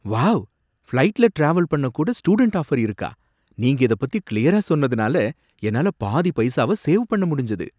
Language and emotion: Tamil, surprised